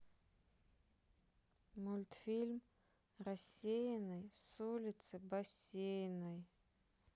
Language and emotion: Russian, neutral